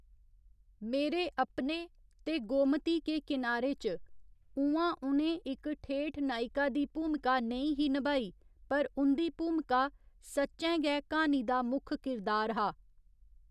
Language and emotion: Dogri, neutral